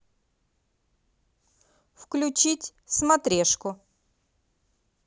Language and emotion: Russian, positive